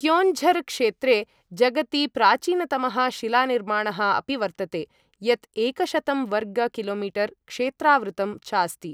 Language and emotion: Sanskrit, neutral